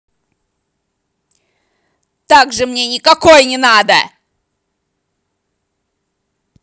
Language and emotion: Russian, angry